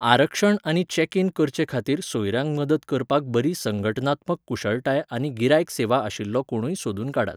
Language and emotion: Goan Konkani, neutral